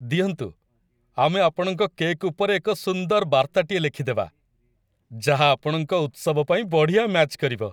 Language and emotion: Odia, happy